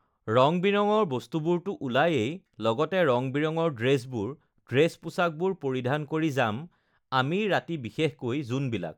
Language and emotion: Assamese, neutral